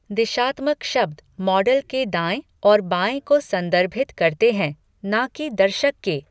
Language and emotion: Hindi, neutral